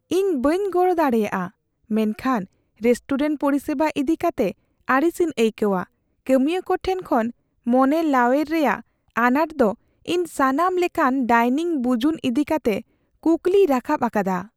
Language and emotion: Santali, fearful